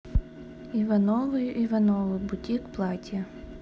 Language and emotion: Russian, neutral